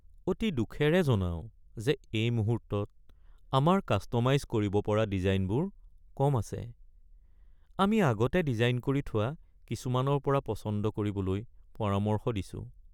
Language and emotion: Assamese, sad